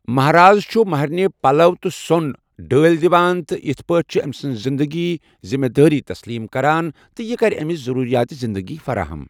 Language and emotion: Kashmiri, neutral